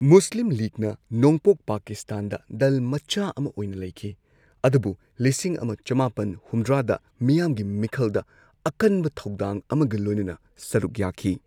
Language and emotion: Manipuri, neutral